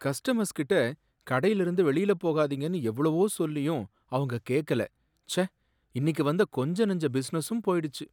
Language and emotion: Tamil, sad